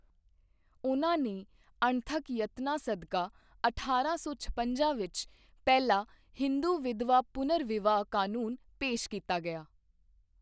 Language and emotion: Punjabi, neutral